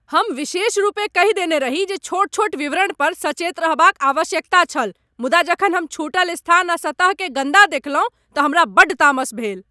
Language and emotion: Maithili, angry